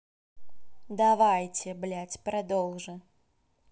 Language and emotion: Russian, angry